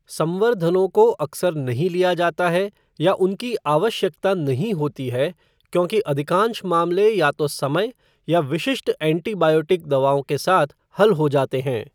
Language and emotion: Hindi, neutral